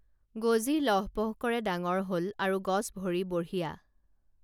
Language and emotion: Assamese, neutral